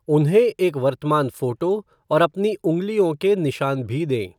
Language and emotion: Hindi, neutral